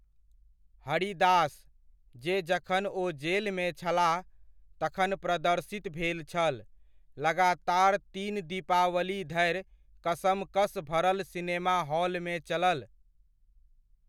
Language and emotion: Maithili, neutral